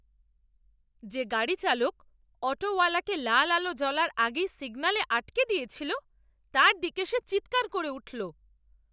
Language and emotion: Bengali, angry